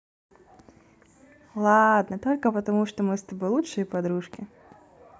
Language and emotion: Russian, positive